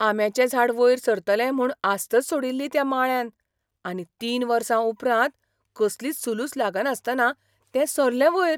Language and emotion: Goan Konkani, surprised